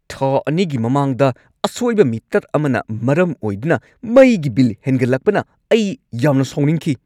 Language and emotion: Manipuri, angry